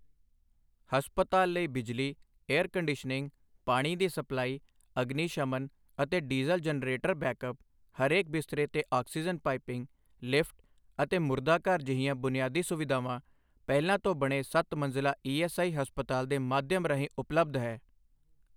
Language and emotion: Punjabi, neutral